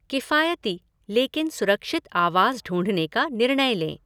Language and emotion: Hindi, neutral